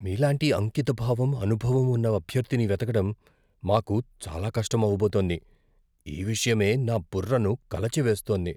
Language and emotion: Telugu, fearful